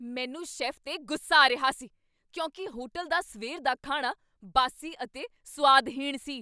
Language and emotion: Punjabi, angry